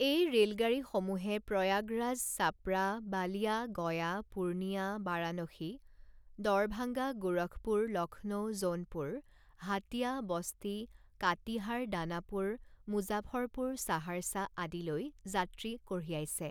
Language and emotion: Assamese, neutral